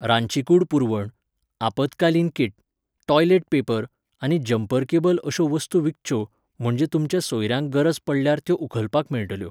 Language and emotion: Goan Konkani, neutral